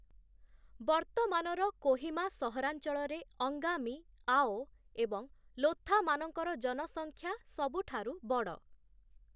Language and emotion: Odia, neutral